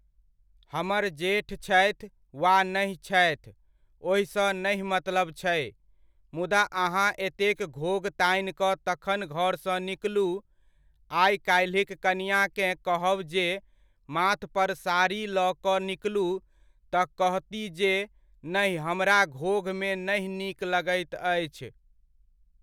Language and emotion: Maithili, neutral